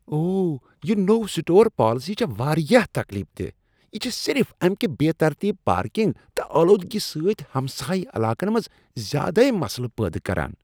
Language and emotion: Kashmiri, disgusted